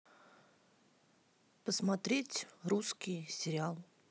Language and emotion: Russian, neutral